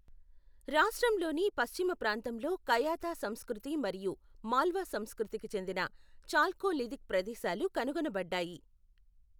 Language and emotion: Telugu, neutral